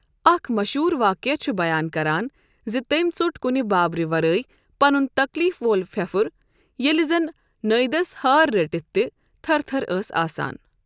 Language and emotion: Kashmiri, neutral